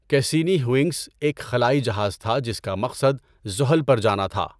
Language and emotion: Urdu, neutral